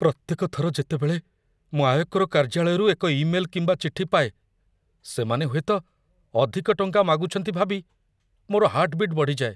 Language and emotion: Odia, fearful